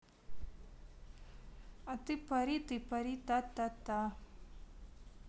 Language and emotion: Russian, neutral